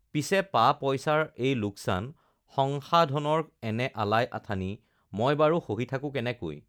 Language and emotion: Assamese, neutral